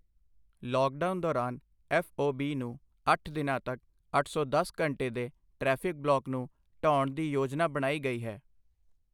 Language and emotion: Punjabi, neutral